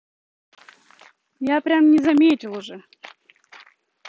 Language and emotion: Russian, neutral